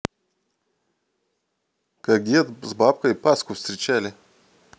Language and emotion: Russian, neutral